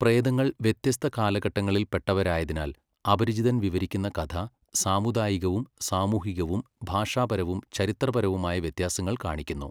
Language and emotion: Malayalam, neutral